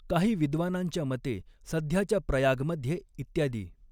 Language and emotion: Marathi, neutral